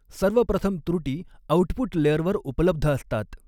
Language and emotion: Marathi, neutral